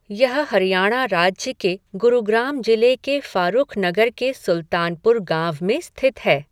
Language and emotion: Hindi, neutral